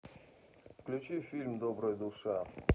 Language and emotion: Russian, neutral